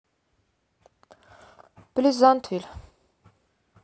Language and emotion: Russian, neutral